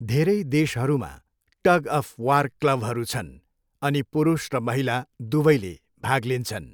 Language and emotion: Nepali, neutral